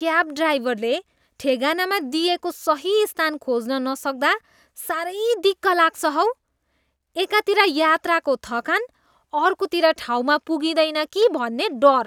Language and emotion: Nepali, disgusted